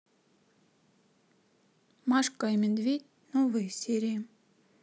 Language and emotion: Russian, neutral